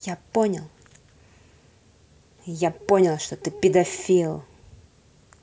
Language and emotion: Russian, angry